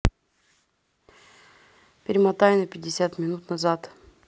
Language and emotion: Russian, neutral